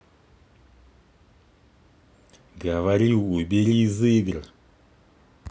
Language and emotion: Russian, angry